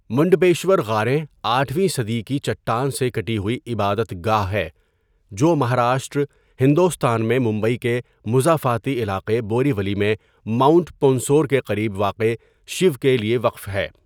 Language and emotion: Urdu, neutral